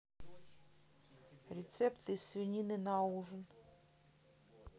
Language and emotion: Russian, neutral